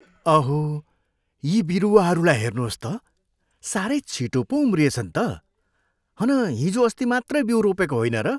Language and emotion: Nepali, surprised